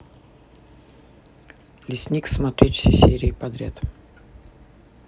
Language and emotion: Russian, neutral